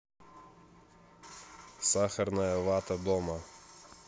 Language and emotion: Russian, neutral